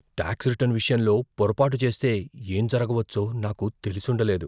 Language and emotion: Telugu, fearful